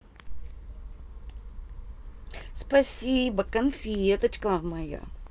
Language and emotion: Russian, positive